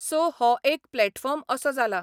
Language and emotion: Goan Konkani, neutral